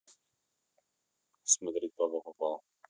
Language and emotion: Russian, neutral